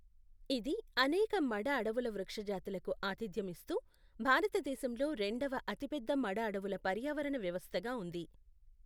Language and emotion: Telugu, neutral